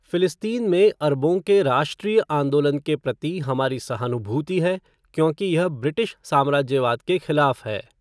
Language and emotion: Hindi, neutral